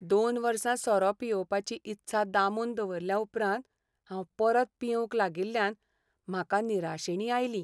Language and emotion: Goan Konkani, sad